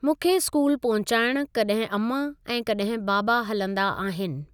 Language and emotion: Sindhi, neutral